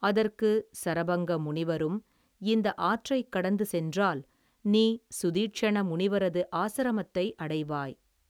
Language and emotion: Tamil, neutral